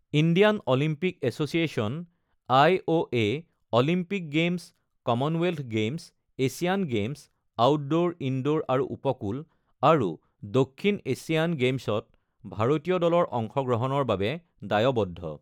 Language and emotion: Assamese, neutral